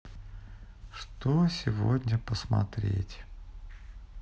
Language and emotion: Russian, sad